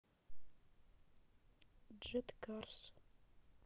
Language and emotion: Russian, sad